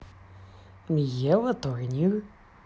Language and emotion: Russian, positive